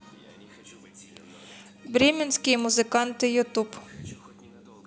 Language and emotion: Russian, neutral